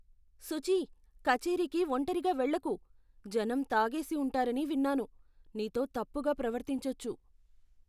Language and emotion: Telugu, fearful